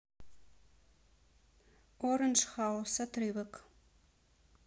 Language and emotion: Russian, neutral